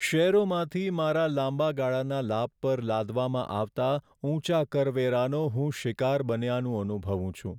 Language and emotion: Gujarati, sad